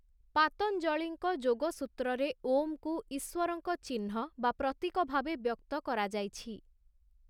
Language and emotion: Odia, neutral